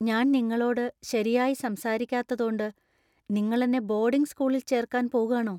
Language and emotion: Malayalam, fearful